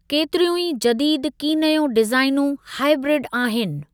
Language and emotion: Sindhi, neutral